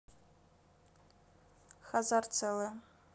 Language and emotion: Russian, neutral